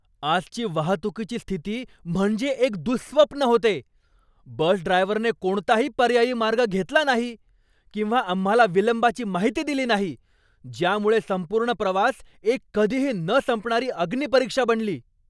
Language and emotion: Marathi, angry